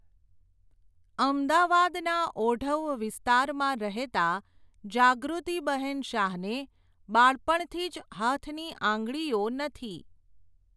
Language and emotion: Gujarati, neutral